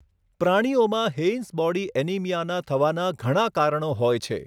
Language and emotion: Gujarati, neutral